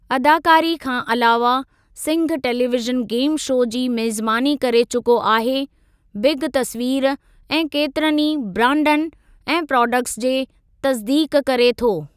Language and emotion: Sindhi, neutral